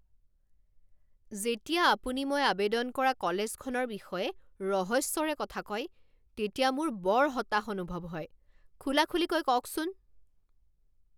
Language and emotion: Assamese, angry